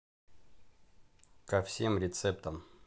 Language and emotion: Russian, neutral